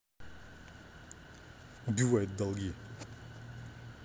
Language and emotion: Russian, angry